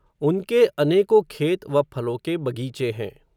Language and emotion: Hindi, neutral